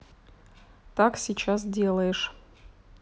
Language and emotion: Russian, neutral